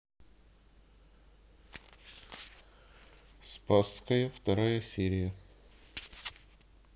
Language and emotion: Russian, neutral